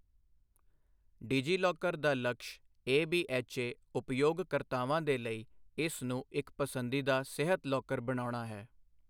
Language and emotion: Punjabi, neutral